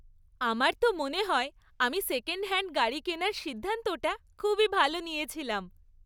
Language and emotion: Bengali, happy